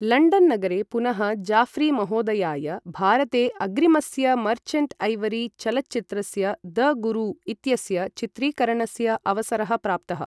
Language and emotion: Sanskrit, neutral